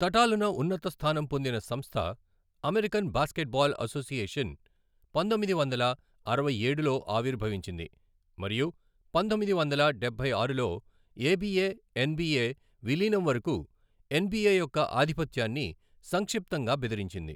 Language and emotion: Telugu, neutral